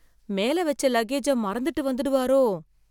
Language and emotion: Tamil, fearful